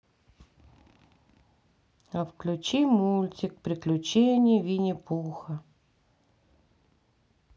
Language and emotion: Russian, sad